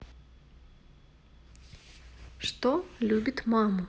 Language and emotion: Russian, neutral